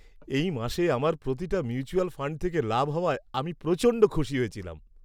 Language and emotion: Bengali, happy